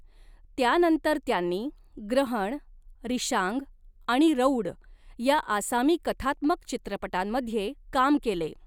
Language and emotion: Marathi, neutral